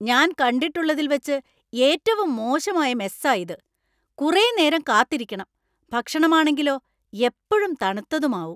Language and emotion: Malayalam, angry